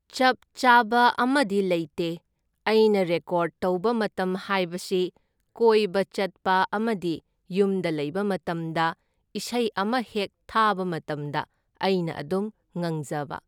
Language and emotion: Manipuri, neutral